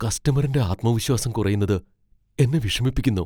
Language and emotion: Malayalam, fearful